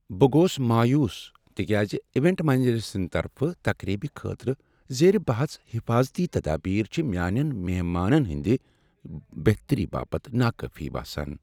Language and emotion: Kashmiri, sad